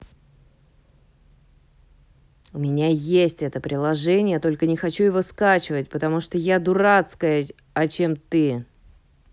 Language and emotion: Russian, angry